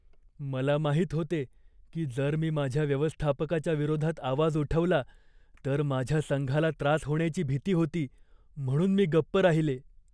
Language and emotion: Marathi, fearful